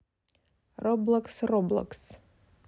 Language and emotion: Russian, neutral